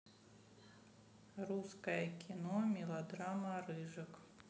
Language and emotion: Russian, neutral